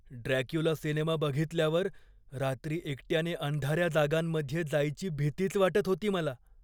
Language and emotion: Marathi, fearful